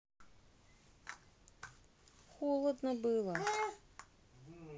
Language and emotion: Russian, sad